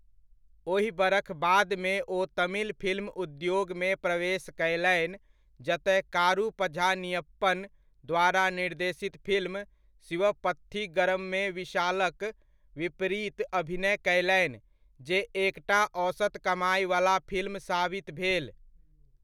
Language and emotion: Maithili, neutral